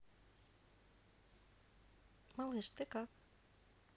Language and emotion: Russian, neutral